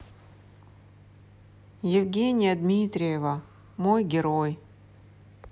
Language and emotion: Russian, sad